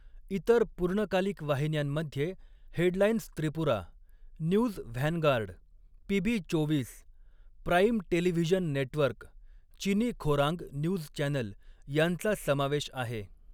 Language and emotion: Marathi, neutral